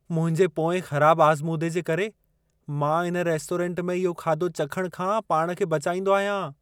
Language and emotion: Sindhi, fearful